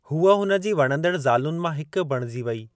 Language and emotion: Sindhi, neutral